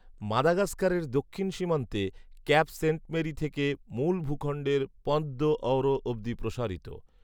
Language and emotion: Bengali, neutral